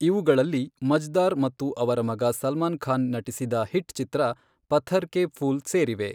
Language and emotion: Kannada, neutral